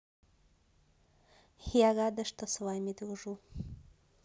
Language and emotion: Russian, neutral